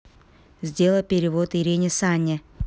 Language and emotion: Russian, neutral